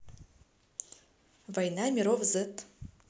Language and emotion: Russian, neutral